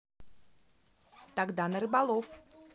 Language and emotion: Russian, positive